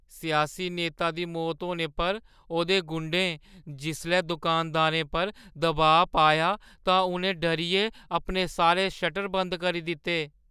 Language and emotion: Dogri, fearful